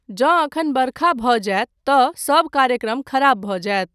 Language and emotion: Maithili, neutral